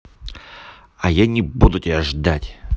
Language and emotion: Russian, angry